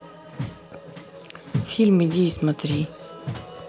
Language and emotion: Russian, neutral